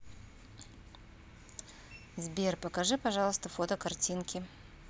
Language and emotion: Russian, neutral